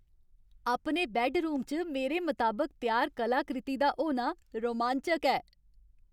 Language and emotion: Dogri, happy